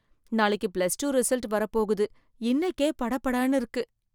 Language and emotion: Tamil, fearful